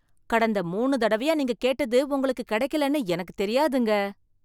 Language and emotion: Tamil, surprised